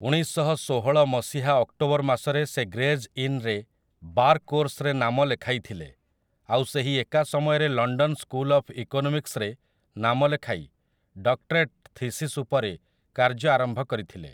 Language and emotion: Odia, neutral